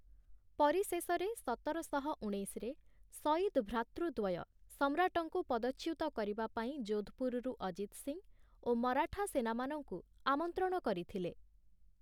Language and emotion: Odia, neutral